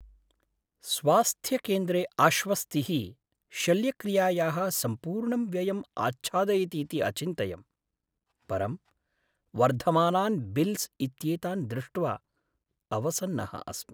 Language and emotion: Sanskrit, sad